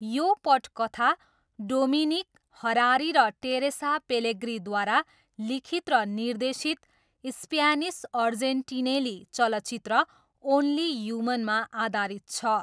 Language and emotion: Nepali, neutral